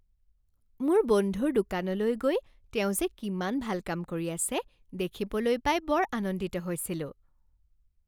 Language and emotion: Assamese, happy